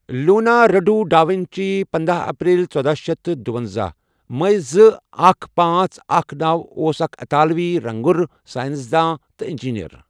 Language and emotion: Kashmiri, neutral